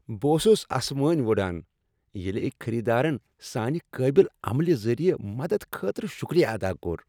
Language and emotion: Kashmiri, happy